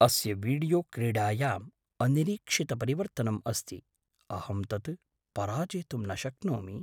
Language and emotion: Sanskrit, surprised